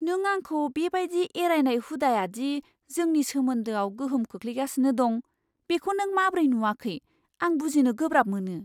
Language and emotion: Bodo, surprised